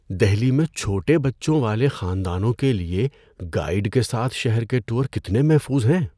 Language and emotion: Urdu, fearful